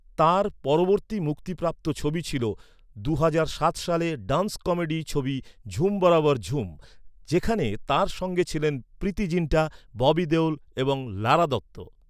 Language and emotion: Bengali, neutral